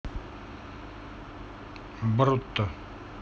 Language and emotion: Russian, neutral